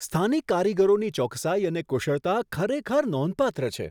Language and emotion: Gujarati, surprised